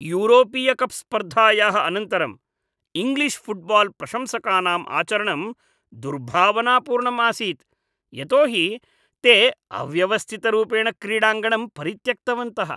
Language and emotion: Sanskrit, disgusted